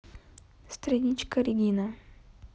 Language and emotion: Russian, neutral